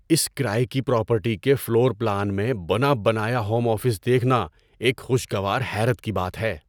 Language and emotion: Urdu, surprised